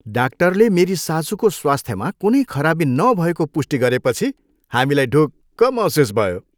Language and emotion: Nepali, happy